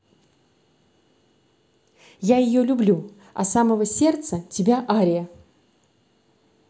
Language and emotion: Russian, positive